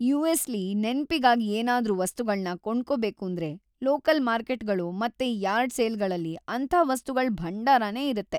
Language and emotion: Kannada, happy